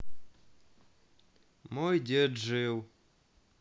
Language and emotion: Russian, sad